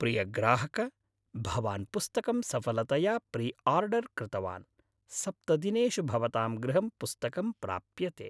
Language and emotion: Sanskrit, happy